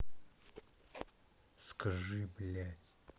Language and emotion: Russian, angry